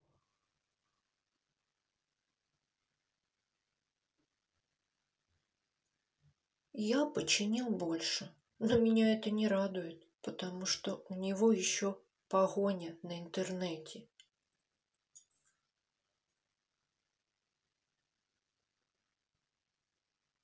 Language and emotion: Russian, sad